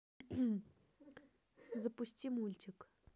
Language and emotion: Russian, neutral